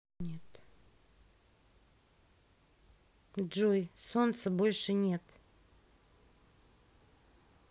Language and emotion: Russian, sad